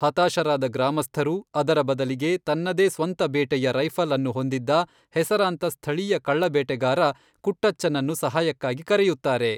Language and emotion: Kannada, neutral